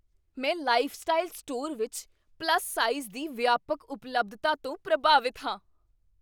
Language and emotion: Punjabi, surprised